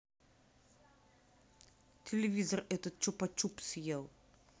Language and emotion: Russian, neutral